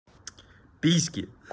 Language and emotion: Russian, neutral